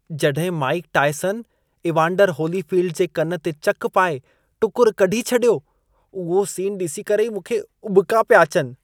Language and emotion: Sindhi, disgusted